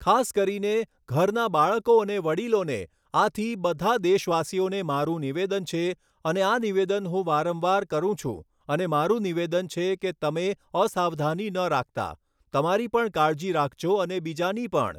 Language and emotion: Gujarati, neutral